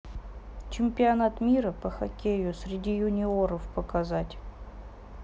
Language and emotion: Russian, neutral